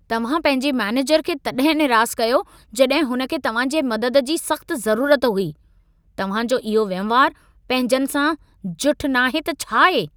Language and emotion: Sindhi, angry